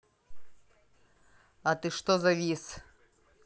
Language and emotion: Russian, angry